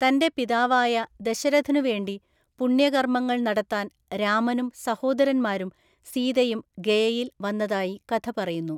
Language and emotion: Malayalam, neutral